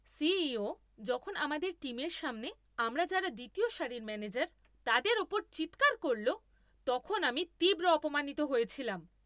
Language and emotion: Bengali, angry